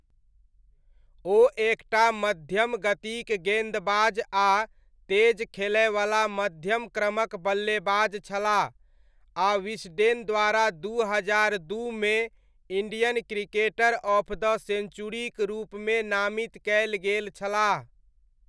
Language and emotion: Maithili, neutral